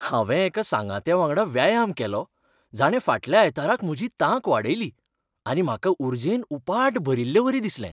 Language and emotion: Goan Konkani, happy